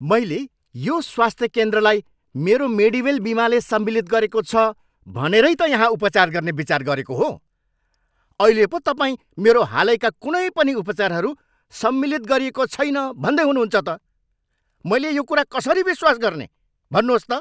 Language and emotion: Nepali, angry